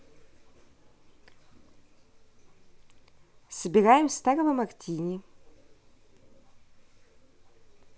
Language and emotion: Russian, neutral